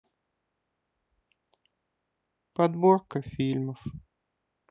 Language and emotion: Russian, sad